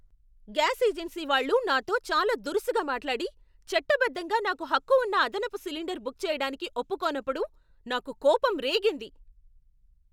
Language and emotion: Telugu, angry